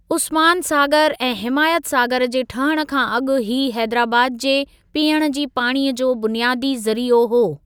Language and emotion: Sindhi, neutral